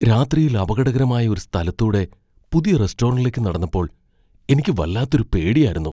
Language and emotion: Malayalam, fearful